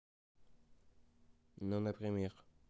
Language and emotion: Russian, neutral